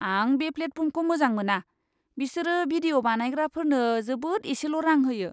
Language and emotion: Bodo, disgusted